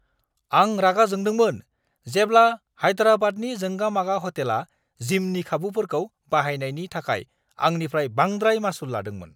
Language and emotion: Bodo, angry